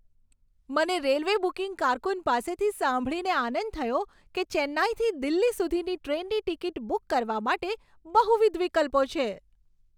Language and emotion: Gujarati, happy